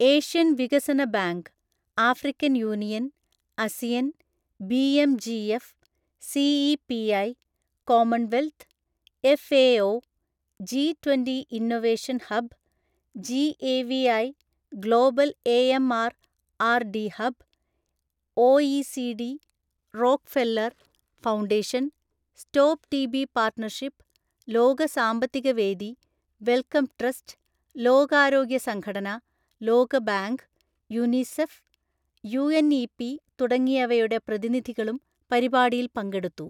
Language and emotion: Malayalam, neutral